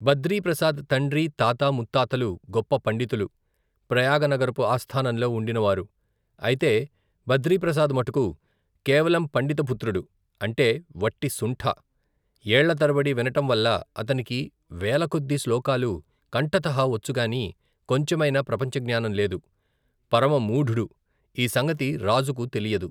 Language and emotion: Telugu, neutral